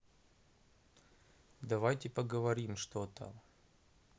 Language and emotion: Russian, neutral